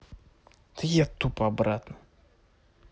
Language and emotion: Russian, angry